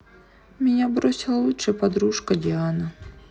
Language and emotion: Russian, sad